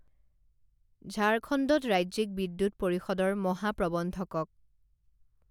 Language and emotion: Assamese, neutral